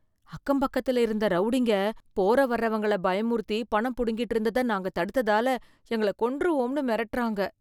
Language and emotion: Tamil, fearful